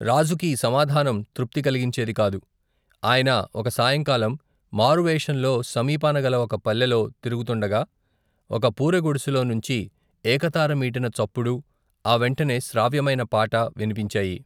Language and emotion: Telugu, neutral